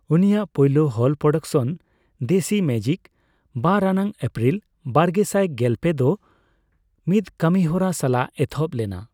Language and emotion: Santali, neutral